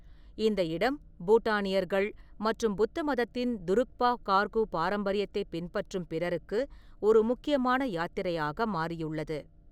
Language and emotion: Tamil, neutral